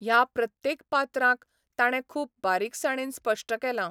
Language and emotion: Goan Konkani, neutral